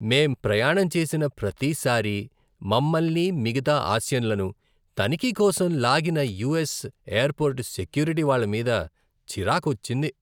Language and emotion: Telugu, disgusted